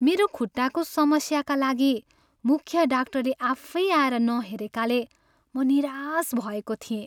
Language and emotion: Nepali, sad